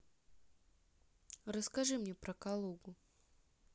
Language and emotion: Russian, neutral